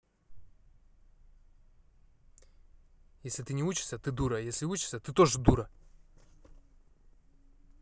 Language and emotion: Russian, angry